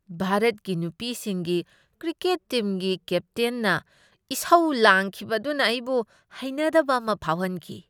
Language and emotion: Manipuri, disgusted